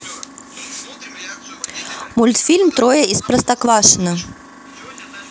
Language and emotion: Russian, neutral